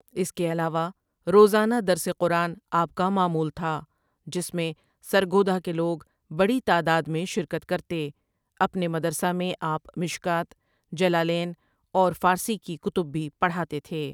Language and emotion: Urdu, neutral